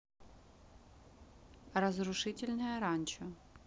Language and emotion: Russian, neutral